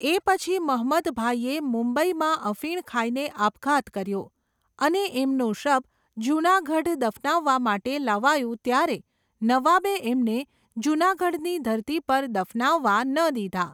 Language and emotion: Gujarati, neutral